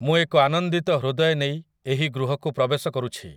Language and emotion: Odia, neutral